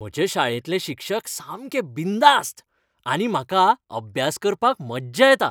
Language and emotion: Goan Konkani, happy